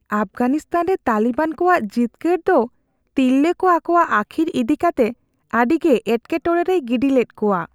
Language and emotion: Santali, fearful